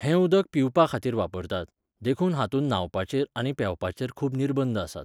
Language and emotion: Goan Konkani, neutral